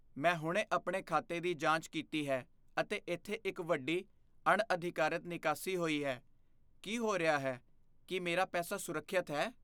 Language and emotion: Punjabi, fearful